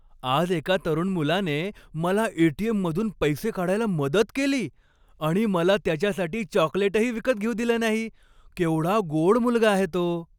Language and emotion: Marathi, happy